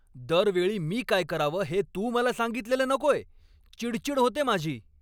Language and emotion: Marathi, angry